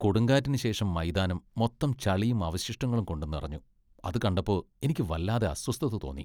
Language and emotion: Malayalam, disgusted